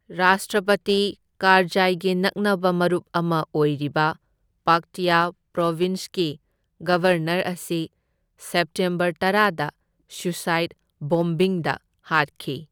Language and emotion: Manipuri, neutral